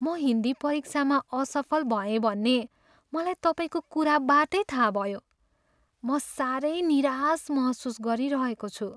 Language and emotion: Nepali, sad